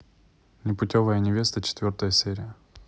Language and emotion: Russian, neutral